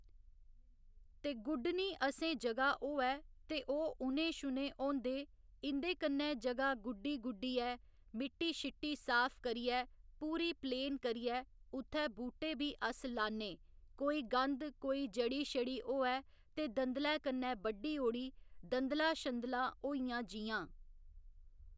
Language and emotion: Dogri, neutral